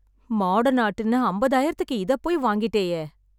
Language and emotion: Tamil, sad